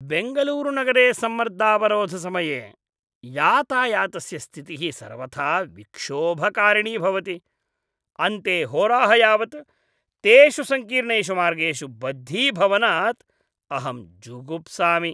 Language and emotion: Sanskrit, disgusted